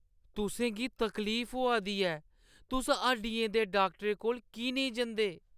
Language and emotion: Dogri, sad